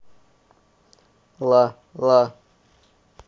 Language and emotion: Russian, neutral